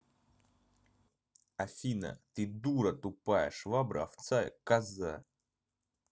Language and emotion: Russian, angry